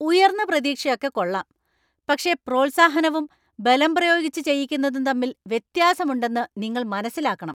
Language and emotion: Malayalam, angry